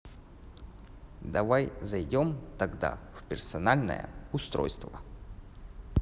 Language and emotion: Russian, neutral